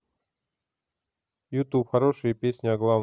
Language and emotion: Russian, neutral